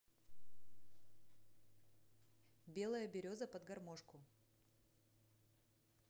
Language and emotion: Russian, neutral